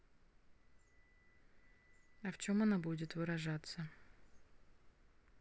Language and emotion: Russian, neutral